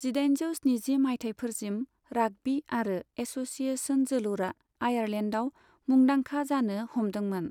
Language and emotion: Bodo, neutral